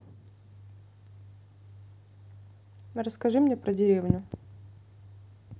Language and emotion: Russian, neutral